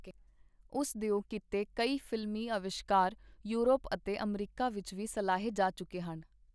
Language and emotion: Punjabi, neutral